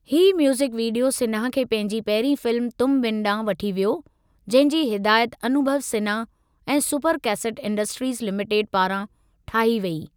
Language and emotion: Sindhi, neutral